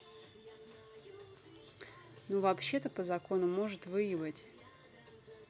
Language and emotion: Russian, neutral